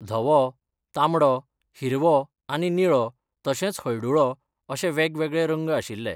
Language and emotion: Goan Konkani, neutral